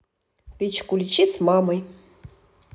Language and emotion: Russian, neutral